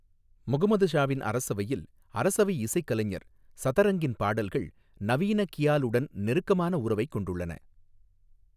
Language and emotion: Tamil, neutral